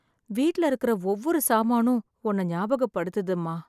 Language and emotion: Tamil, sad